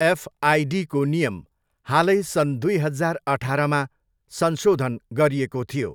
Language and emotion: Nepali, neutral